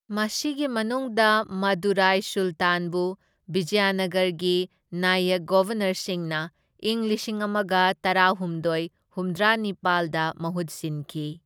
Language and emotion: Manipuri, neutral